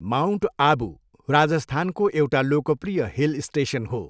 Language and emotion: Nepali, neutral